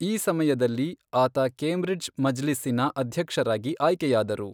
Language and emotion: Kannada, neutral